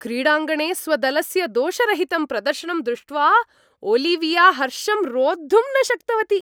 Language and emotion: Sanskrit, happy